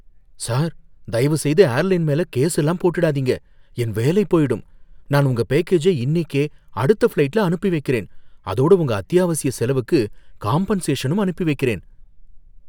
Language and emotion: Tamil, fearful